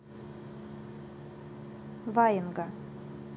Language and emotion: Russian, neutral